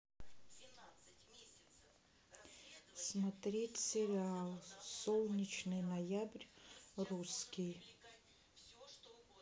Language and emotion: Russian, neutral